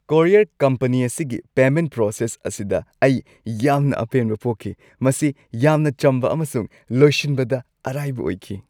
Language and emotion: Manipuri, happy